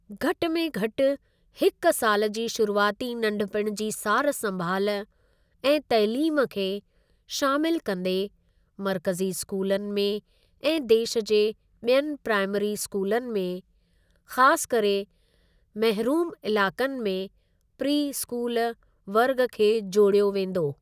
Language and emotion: Sindhi, neutral